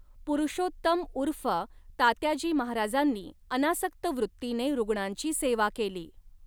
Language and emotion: Marathi, neutral